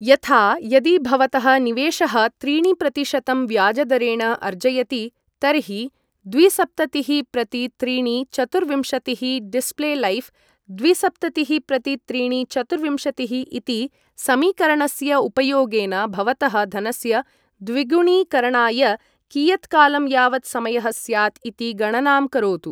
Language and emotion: Sanskrit, neutral